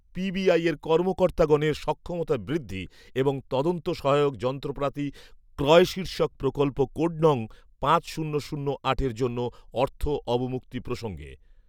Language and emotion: Bengali, neutral